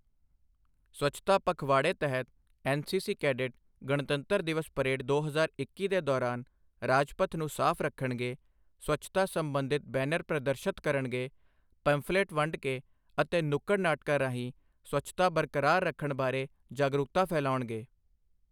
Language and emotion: Punjabi, neutral